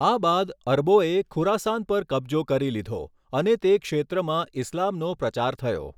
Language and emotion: Gujarati, neutral